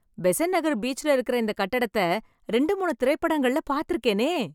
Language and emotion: Tamil, happy